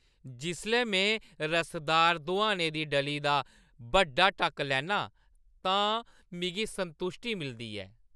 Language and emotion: Dogri, happy